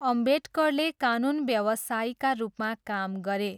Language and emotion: Nepali, neutral